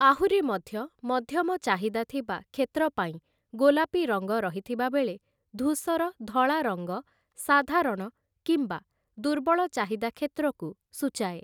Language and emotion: Odia, neutral